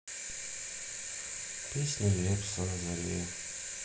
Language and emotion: Russian, sad